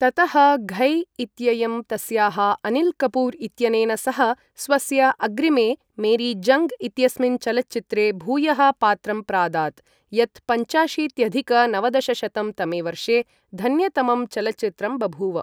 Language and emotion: Sanskrit, neutral